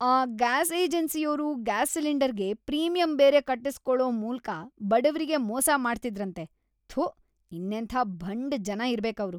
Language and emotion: Kannada, disgusted